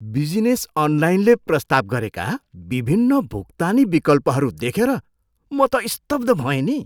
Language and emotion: Nepali, surprised